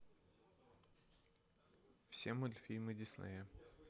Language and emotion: Russian, neutral